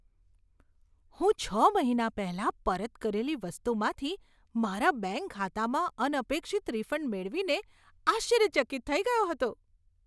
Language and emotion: Gujarati, surprised